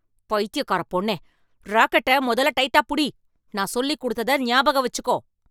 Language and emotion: Tamil, angry